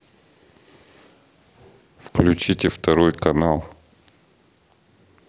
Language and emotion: Russian, neutral